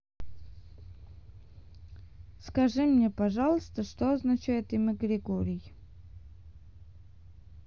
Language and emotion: Russian, neutral